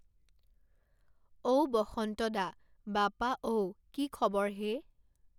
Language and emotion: Assamese, neutral